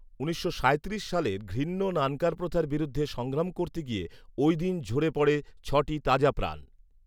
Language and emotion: Bengali, neutral